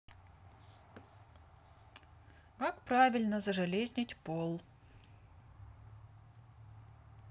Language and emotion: Russian, neutral